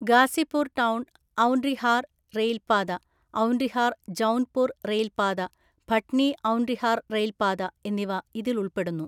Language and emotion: Malayalam, neutral